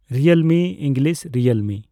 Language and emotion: Santali, neutral